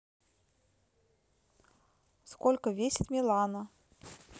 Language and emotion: Russian, neutral